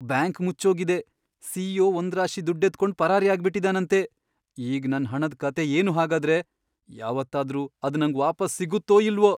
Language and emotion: Kannada, fearful